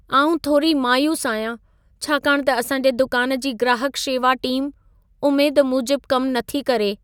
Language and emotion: Sindhi, sad